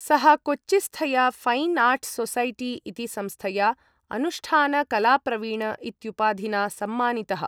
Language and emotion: Sanskrit, neutral